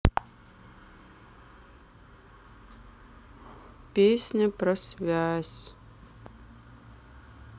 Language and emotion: Russian, sad